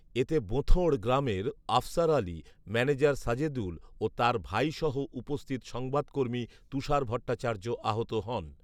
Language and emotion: Bengali, neutral